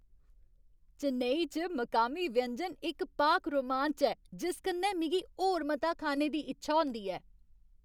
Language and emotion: Dogri, happy